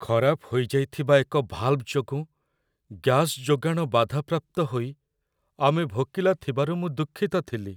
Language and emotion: Odia, sad